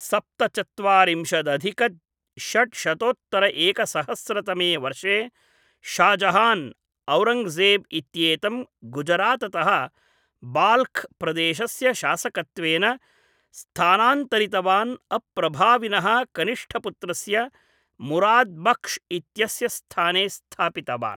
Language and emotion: Sanskrit, neutral